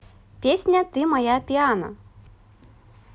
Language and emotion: Russian, positive